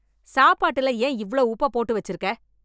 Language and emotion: Tamil, angry